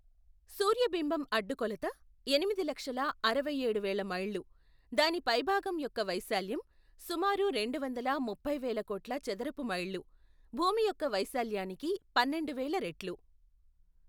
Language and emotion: Telugu, neutral